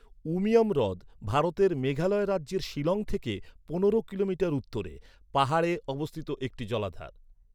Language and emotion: Bengali, neutral